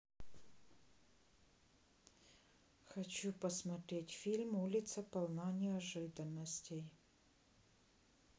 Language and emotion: Russian, neutral